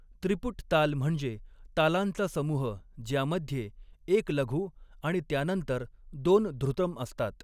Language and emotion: Marathi, neutral